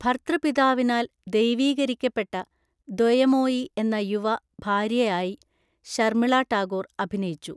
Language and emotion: Malayalam, neutral